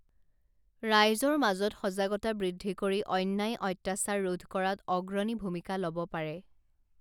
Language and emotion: Assamese, neutral